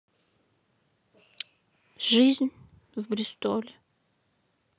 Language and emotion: Russian, neutral